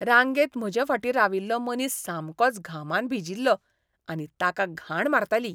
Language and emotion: Goan Konkani, disgusted